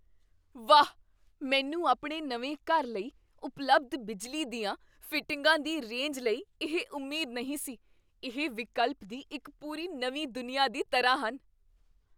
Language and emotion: Punjabi, surprised